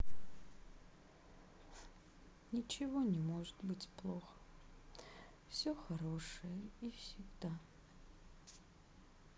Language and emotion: Russian, sad